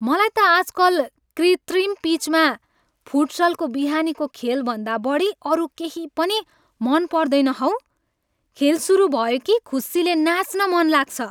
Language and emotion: Nepali, happy